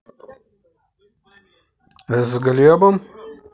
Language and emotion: Russian, neutral